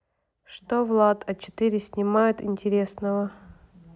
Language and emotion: Russian, neutral